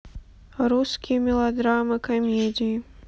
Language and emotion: Russian, neutral